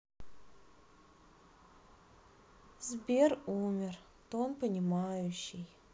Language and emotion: Russian, sad